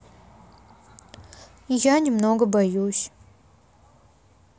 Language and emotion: Russian, sad